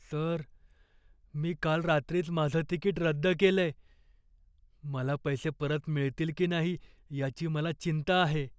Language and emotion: Marathi, fearful